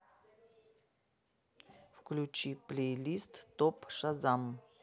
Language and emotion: Russian, neutral